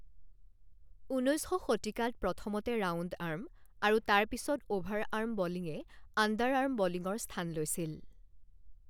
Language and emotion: Assamese, neutral